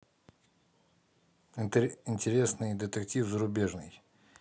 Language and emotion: Russian, neutral